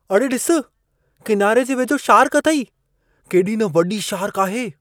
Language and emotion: Sindhi, surprised